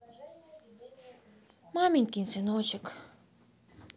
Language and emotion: Russian, sad